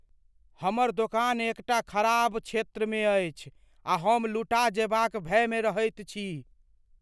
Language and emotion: Maithili, fearful